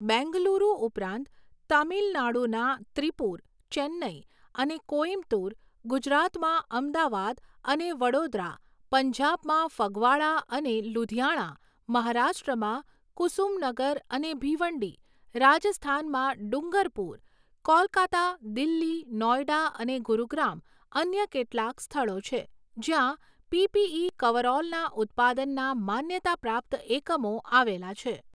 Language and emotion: Gujarati, neutral